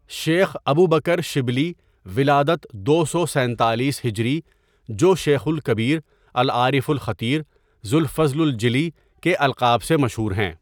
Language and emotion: Urdu, neutral